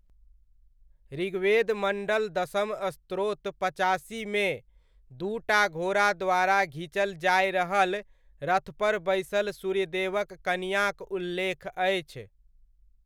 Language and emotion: Maithili, neutral